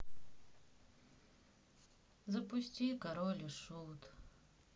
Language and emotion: Russian, sad